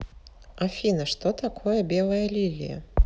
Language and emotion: Russian, neutral